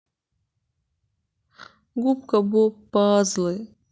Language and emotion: Russian, sad